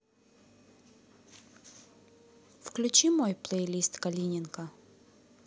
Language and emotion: Russian, neutral